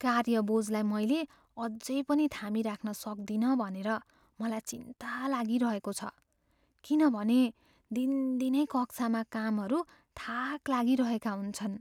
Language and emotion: Nepali, fearful